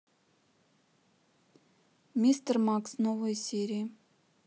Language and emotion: Russian, neutral